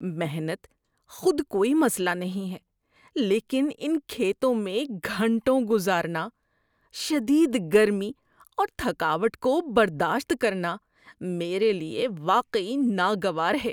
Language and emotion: Urdu, disgusted